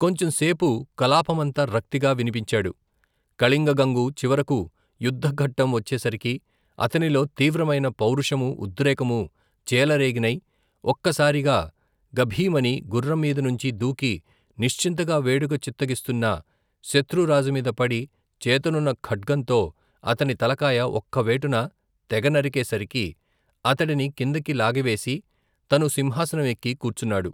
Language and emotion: Telugu, neutral